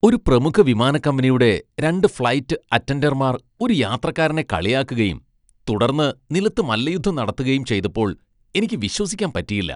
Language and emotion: Malayalam, disgusted